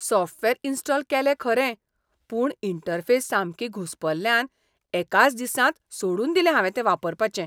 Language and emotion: Goan Konkani, disgusted